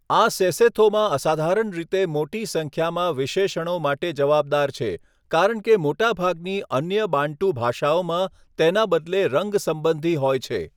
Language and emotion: Gujarati, neutral